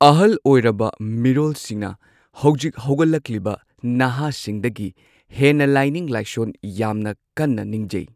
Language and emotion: Manipuri, neutral